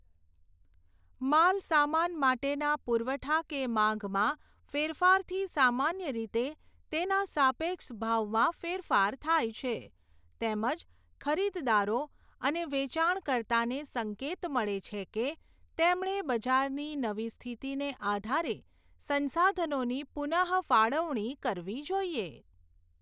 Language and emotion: Gujarati, neutral